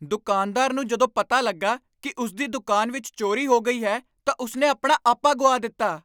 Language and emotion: Punjabi, angry